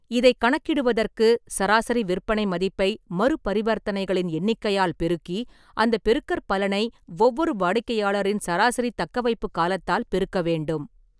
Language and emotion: Tamil, neutral